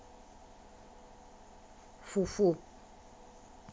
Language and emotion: Russian, angry